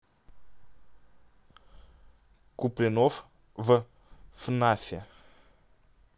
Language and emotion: Russian, neutral